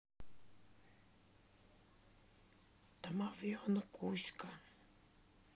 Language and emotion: Russian, neutral